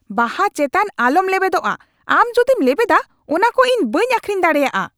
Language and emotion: Santali, angry